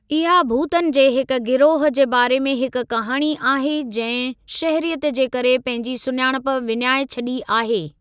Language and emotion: Sindhi, neutral